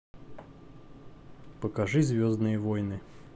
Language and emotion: Russian, neutral